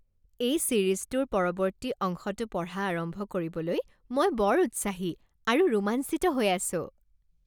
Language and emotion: Assamese, happy